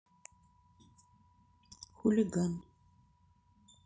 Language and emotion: Russian, neutral